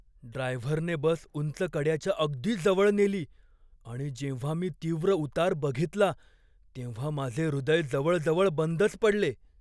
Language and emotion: Marathi, fearful